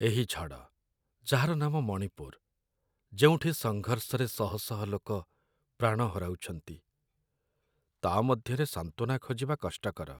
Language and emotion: Odia, sad